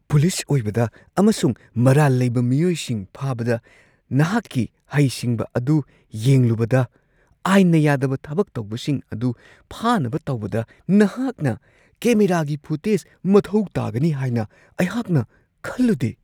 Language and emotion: Manipuri, surprised